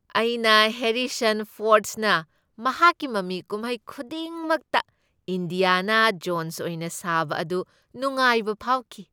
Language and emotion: Manipuri, happy